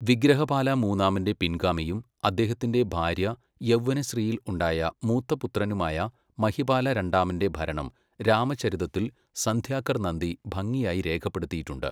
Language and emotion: Malayalam, neutral